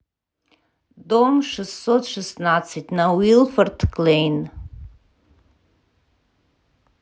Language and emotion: Russian, neutral